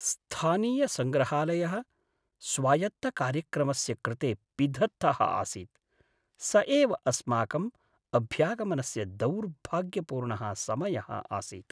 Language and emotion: Sanskrit, sad